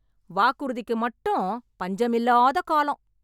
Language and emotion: Tamil, angry